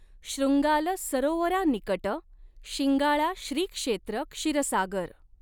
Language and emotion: Marathi, neutral